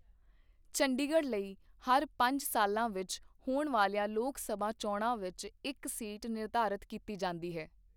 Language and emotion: Punjabi, neutral